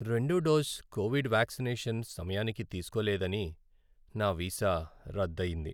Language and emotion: Telugu, sad